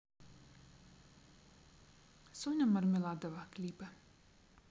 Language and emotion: Russian, neutral